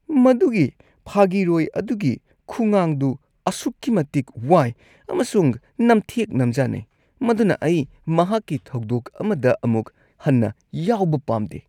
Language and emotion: Manipuri, disgusted